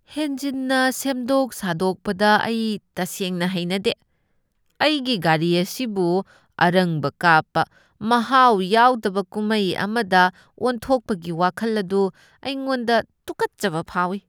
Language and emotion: Manipuri, disgusted